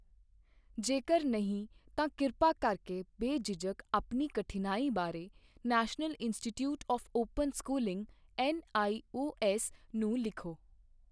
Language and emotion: Punjabi, neutral